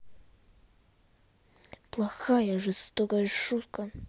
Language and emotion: Russian, angry